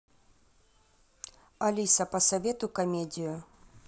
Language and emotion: Russian, neutral